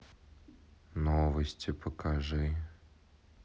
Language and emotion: Russian, sad